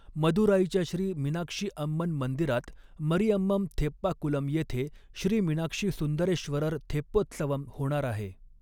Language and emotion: Marathi, neutral